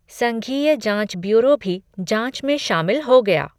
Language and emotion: Hindi, neutral